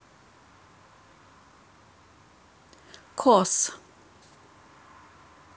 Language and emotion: Russian, neutral